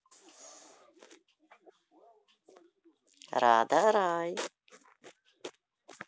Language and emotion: Russian, positive